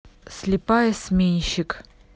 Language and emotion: Russian, neutral